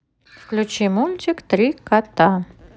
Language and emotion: Russian, neutral